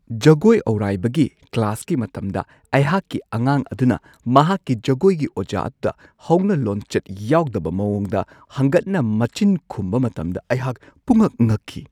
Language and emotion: Manipuri, surprised